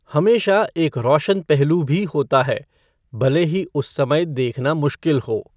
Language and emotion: Hindi, neutral